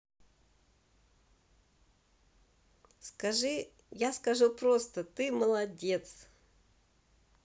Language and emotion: Russian, positive